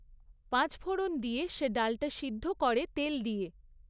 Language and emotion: Bengali, neutral